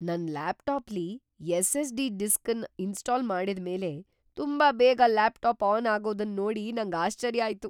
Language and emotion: Kannada, surprised